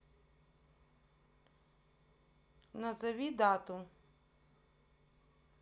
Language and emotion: Russian, neutral